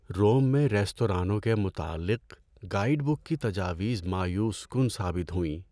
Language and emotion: Urdu, sad